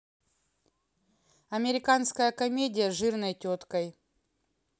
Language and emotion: Russian, neutral